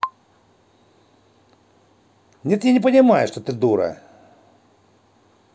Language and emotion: Russian, angry